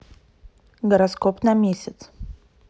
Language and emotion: Russian, neutral